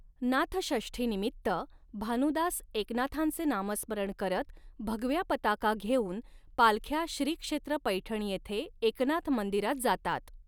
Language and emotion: Marathi, neutral